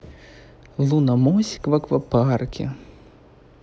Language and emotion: Russian, neutral